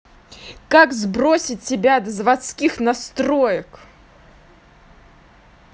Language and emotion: Russian, angry